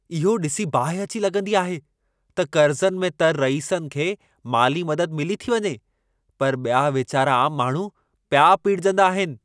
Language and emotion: Sindhi, angry